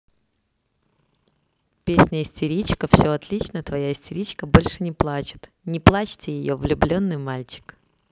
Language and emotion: Russian, positive